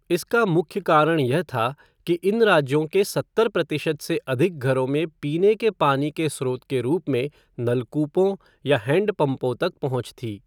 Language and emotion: Hindi, neutral